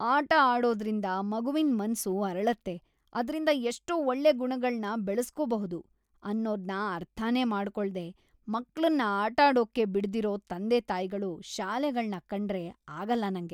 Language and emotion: Kannada, disgusted